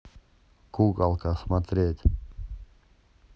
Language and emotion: Russian, neutral